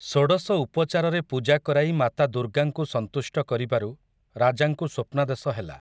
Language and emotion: Odia, neutral